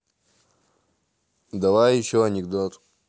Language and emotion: Russian, neutral